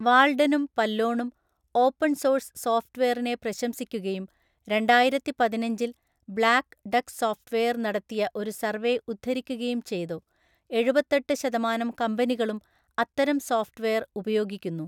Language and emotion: Malayalam, neutral